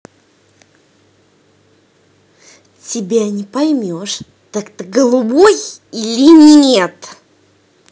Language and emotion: Russian, angry